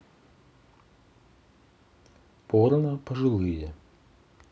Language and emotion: Russian, neutral